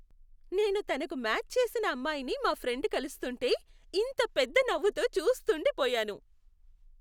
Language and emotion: Telugu, happy